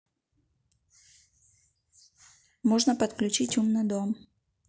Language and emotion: Russian, neutral